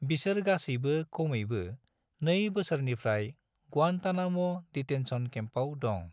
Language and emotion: Bodo, neutral